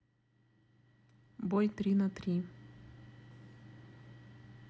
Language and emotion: Russian, neutral